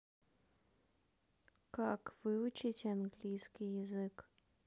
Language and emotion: Russian, neutral